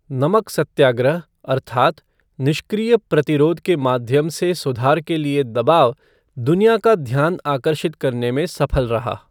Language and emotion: Hindi, neutral